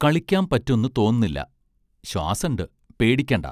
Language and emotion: Malayalam, neutral